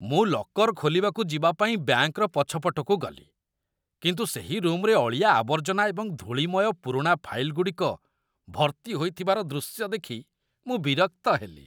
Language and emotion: Odia, disgusted